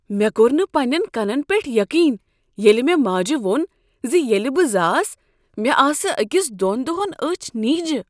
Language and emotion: Kashmiri, surprised